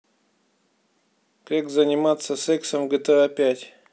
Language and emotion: Russian, neutral